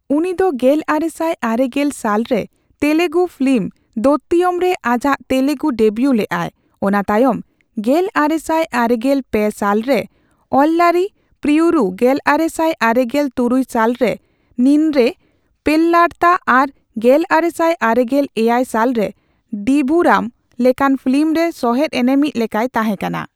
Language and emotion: Santali, neutral